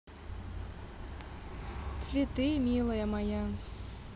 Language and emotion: Russian, neutral